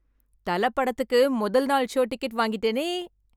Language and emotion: Tamil, happy